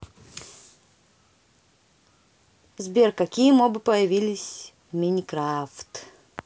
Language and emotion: Russian, neutral